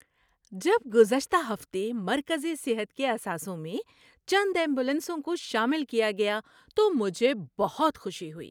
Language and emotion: Urdu, happy